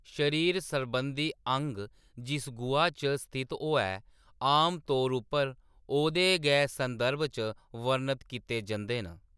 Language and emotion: Dogri, neutral